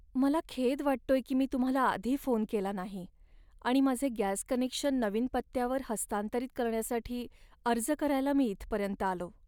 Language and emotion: Marathi, sad